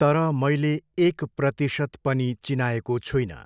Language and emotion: Nepali, neutral